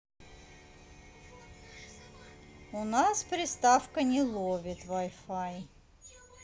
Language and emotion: Russian, neutral